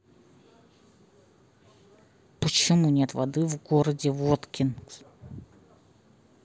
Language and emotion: Russian, angry